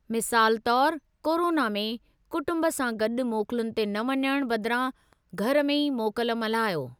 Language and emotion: Sindhi, neutral